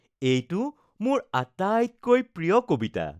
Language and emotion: Assamese, happy